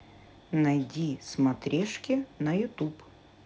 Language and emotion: Russian, neutral